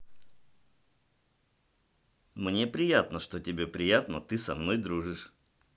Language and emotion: Russian, positive